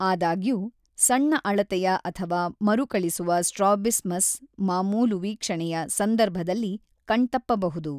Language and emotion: Kannada, neutral